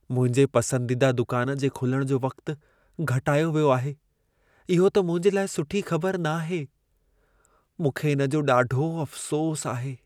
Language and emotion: Sindhi, sad